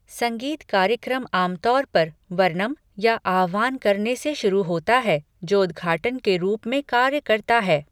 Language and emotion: Hindi, neutral